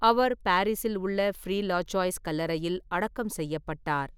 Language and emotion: Tamil, neutral